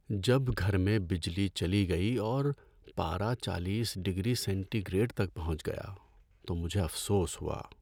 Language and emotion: Urdu, sad